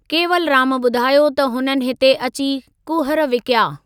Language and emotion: Sindhi, neutral